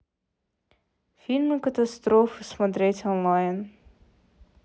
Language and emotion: Russian, neutral